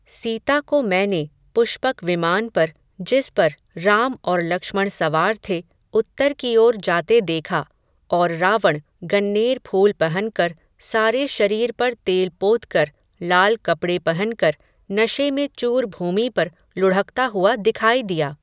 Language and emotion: Hindi, neutral